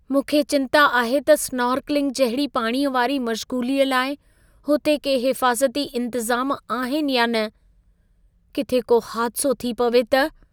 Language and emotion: Sindhi, fearful